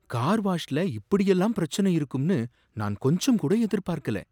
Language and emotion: Tamil, surprised